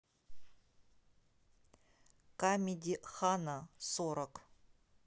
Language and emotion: Russian, neutral